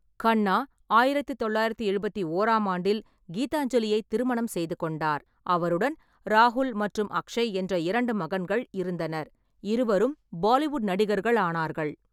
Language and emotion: Tamil, neutral